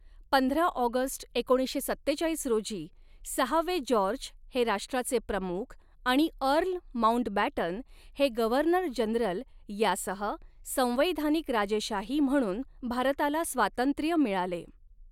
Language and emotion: Marathi, neutral